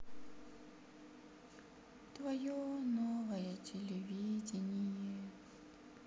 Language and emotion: Russian, sad